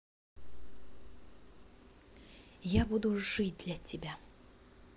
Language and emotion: Russian, positive